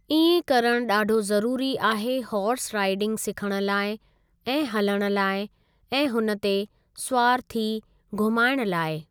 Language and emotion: Sindhi, neutral